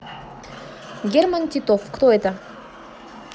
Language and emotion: Russian, neutral